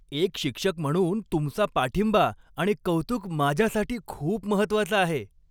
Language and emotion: Marathi, happy